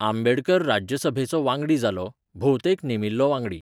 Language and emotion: Goan Konkani, neutral